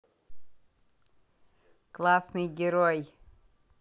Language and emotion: Russian, positive